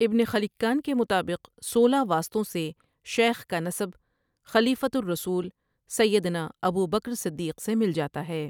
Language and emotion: Urdu, neutral